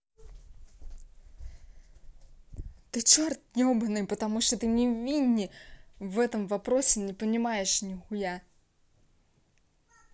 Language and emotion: Russian, neutral